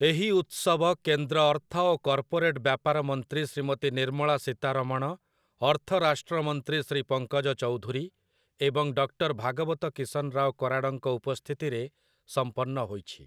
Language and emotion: Odia, neutral